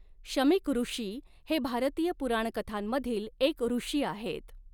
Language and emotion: Marathi, neutral